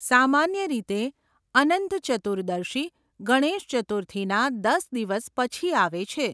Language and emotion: Gujarati, neutral